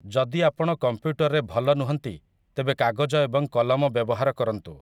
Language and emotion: Odia, neutral